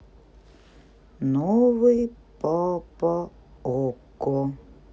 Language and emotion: Russian, sad